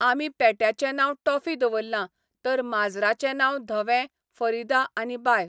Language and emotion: Goan Konkani, neutral